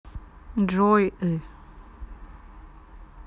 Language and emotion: Russian, neutral